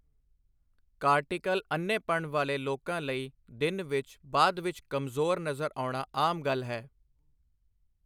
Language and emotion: Punjabi, neutral